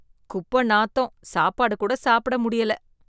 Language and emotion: Tamil, disgusted